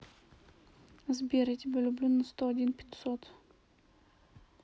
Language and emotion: Russian, neutral